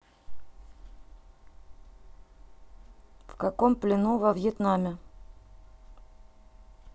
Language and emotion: Russian, neutral